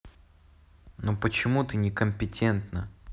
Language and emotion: Russian, neutral